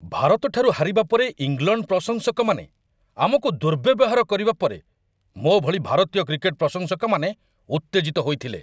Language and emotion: Odia, angry